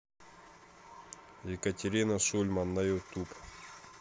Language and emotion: Russian, neutral